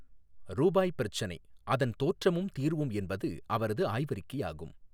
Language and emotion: Tamil, neutral